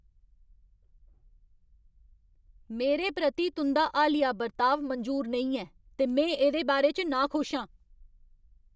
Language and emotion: Dogri, angry